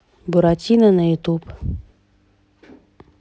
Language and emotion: Russian, neutral